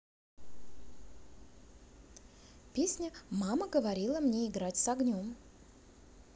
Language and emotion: Russian, positive